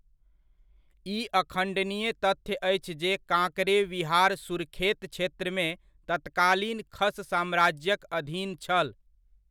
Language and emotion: Maithili, neutral